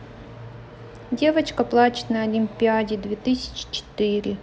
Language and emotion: Russian, neutral